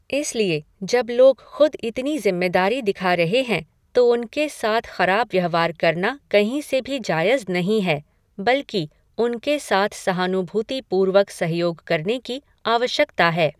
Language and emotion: Hindi, neutral